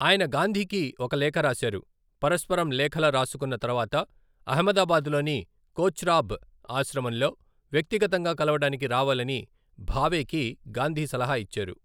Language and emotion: Telugu, neutral